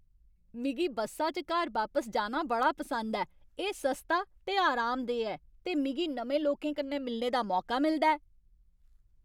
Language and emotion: Dogri, happy